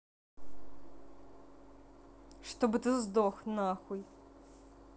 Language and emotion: Russian, angry